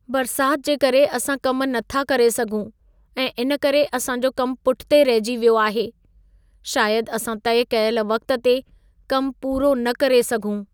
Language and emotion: Sindhi, sad